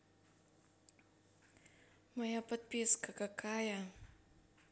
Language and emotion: Russian, neutral